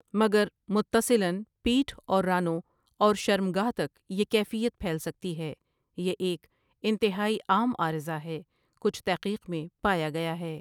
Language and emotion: Urdu, neutral